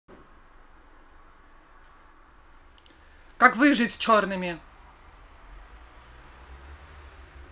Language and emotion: Russian, angry